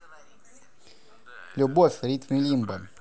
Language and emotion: Russian, positive